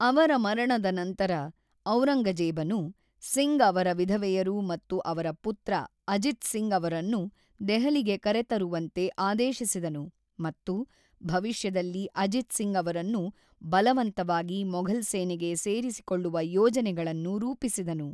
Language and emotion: Kannada, neutral